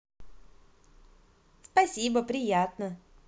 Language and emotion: Russian, positive